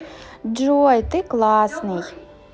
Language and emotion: Russian, positive